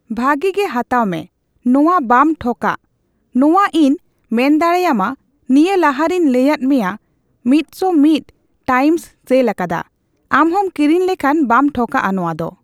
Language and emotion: Santali, neutral